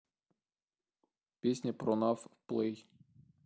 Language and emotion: Russian, neutral